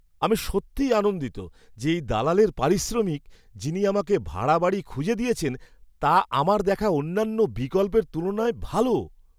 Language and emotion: Bengali, happy